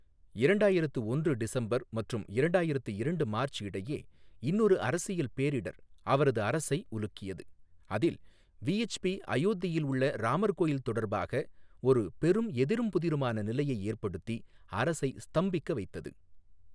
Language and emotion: Tamil, neutral